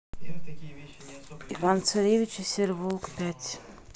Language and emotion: Russian, neutral